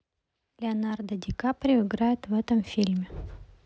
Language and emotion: Russian, neutral